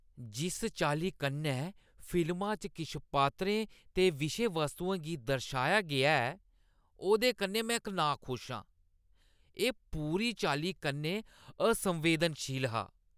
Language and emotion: Dogri, disgusted